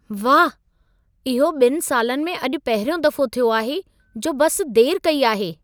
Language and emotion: Sindhi, surprised